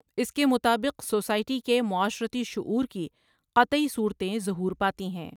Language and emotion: Urdu, neutral